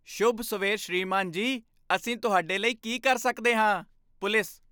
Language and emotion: Punjabi, happy